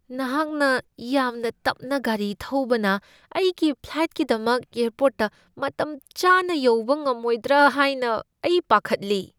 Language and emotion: Manipuri, fearful